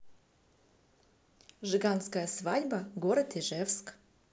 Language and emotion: Russian, neutral